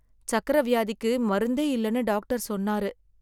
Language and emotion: Tamil, sad